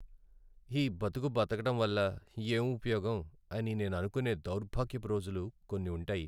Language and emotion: Telugu, sad